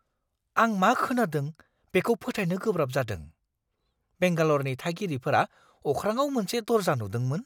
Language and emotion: Bodo, surprised